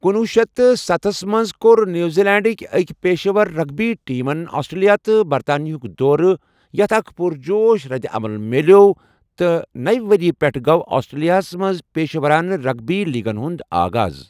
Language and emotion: Kashmiri, neutral